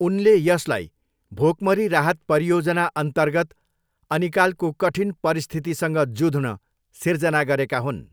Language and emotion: Nepali, neutral